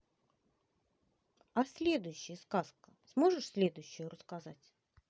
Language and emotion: Russian, neutral